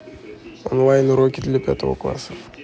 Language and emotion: Russian, neutral